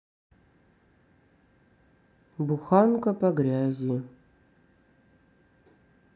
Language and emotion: Russian, sad